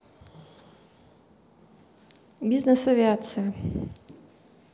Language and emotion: Russian, neutral